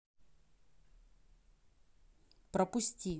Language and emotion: Russian, neutral